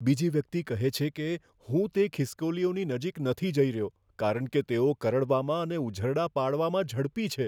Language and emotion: Gujarati, fearful